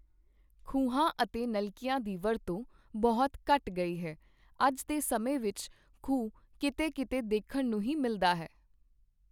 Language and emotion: Punjabi, neutral